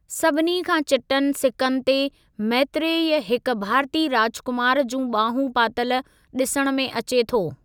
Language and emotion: Sindhi, neutral